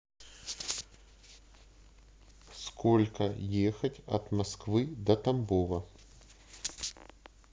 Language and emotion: Russian, neutral